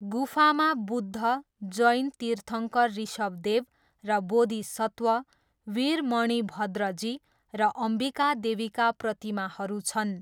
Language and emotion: Nepali, neutral